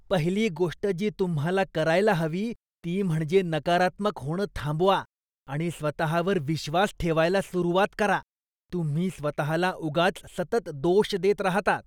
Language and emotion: Marathi, disgusted